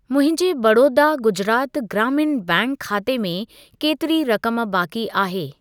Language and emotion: Sindhi, neutral